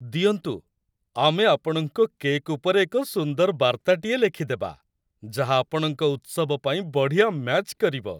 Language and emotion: Odia, happy